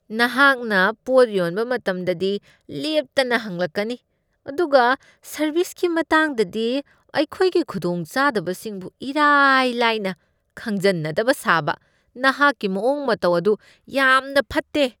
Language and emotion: Manipuri, disgusted